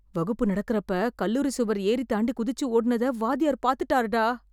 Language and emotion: Tamil, fearful